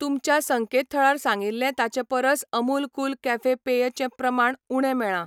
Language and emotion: Goan Konkani, neutral